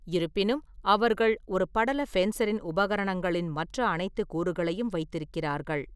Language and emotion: Tamil, neutral